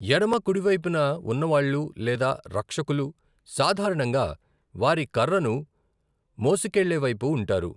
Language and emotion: Telugu, neutral